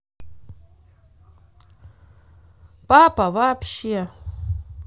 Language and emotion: Russian, positive